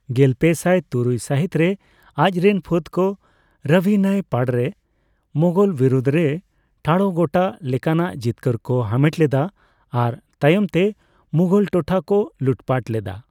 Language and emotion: Santali, neutral